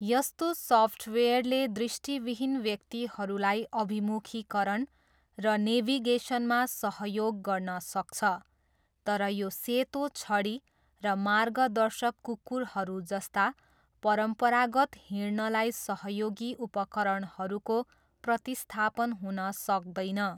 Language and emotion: Nepali, neutral